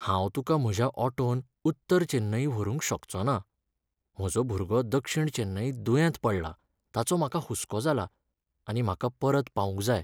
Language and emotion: Goan Konkani, sad